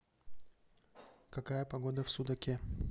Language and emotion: Russian, neutral